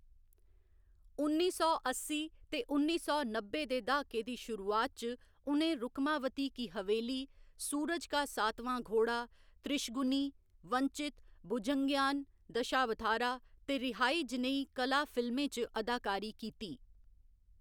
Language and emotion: Dogri, neutral